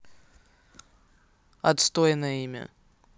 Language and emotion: Russian, neutral